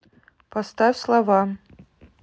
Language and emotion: Russian, neutral